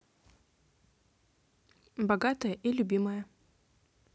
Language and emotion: Russian, neutral